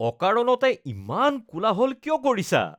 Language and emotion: Assamese, disgusted